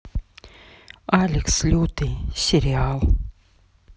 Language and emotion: Russian, neutral